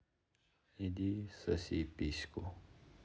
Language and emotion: Russian, sad